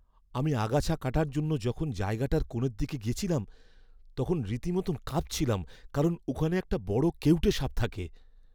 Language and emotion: Bengali, fearful